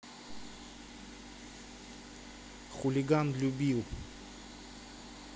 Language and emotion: Russian, neutral